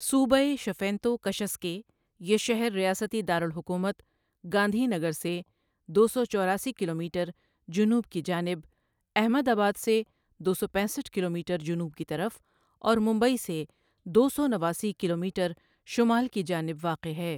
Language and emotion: Urdu, neutral